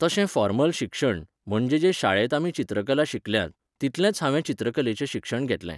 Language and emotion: Goan Konkani, neutral